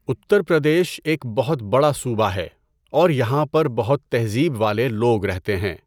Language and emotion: Urdu, neutral